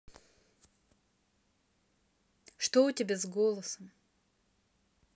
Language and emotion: Russian, neutral